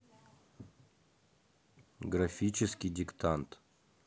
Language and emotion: Russian, neutral